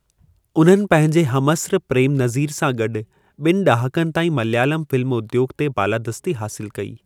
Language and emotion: Sindhi, neutral